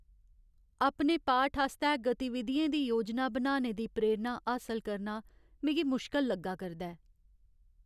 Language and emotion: Dogri, sad